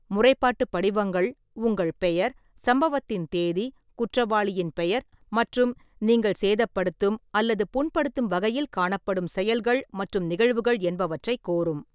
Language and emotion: Tamil, neutral